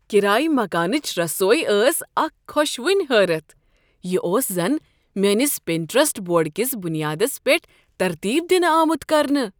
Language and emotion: Kashmiri, surprised